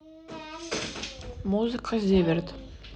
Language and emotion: Russian, neutral